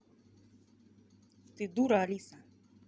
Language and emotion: Russian, angry